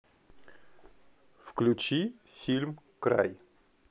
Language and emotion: Russian, neutral